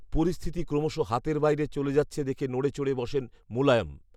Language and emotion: Bengali, neutral